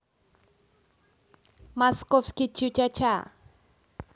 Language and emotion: Russian, positive